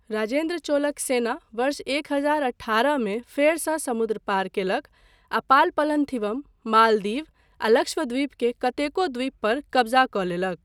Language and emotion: Maithili, neutral